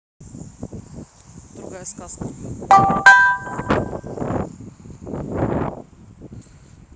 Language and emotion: Russian, neutral